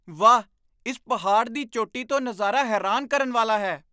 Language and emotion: Punjabi, surprised